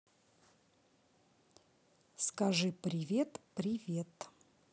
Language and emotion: Russian, neutral